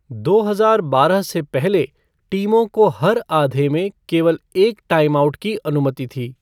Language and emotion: Hindi, neutral